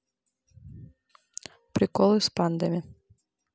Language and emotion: Russian, neutral